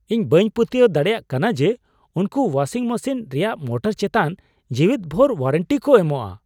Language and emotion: Santali, surprised